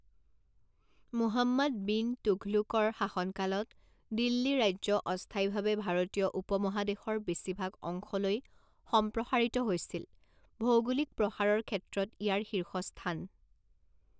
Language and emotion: Assamese, neutral